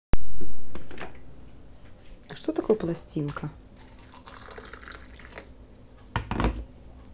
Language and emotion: Russian, neutral